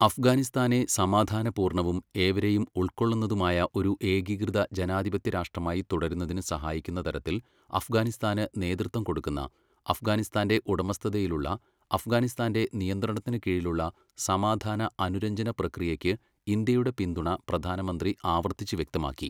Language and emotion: Malayalam, neutral